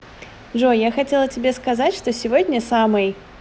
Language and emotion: Russian, positive